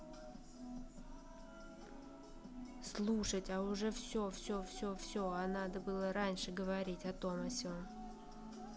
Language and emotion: Russian, neutral